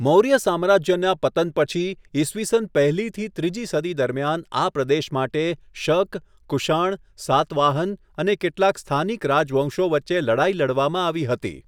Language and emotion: Gujarati, neutral